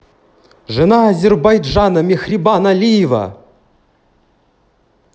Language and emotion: Russian, positive